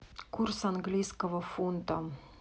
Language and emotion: Russian, neutral